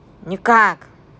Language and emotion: Russian, angry